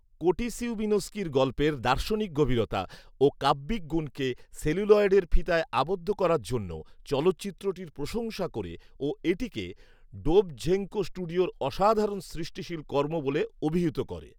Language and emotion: Bengali, neutral